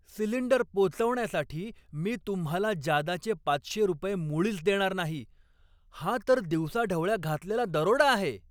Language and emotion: Marathi, angry